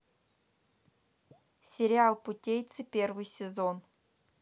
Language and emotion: Russian, neutral